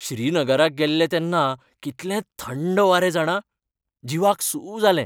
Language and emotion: Goan Konkani, happy